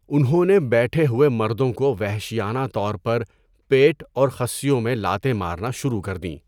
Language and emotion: Urdu, neutral